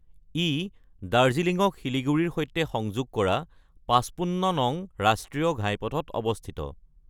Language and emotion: Assamese, neutral